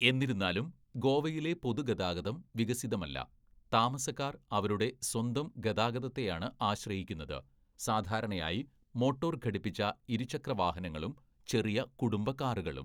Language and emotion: Malayalam, neutral